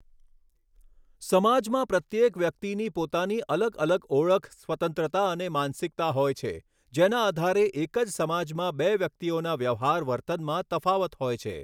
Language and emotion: Gujarati, neutral